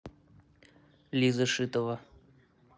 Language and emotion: Russian, neutral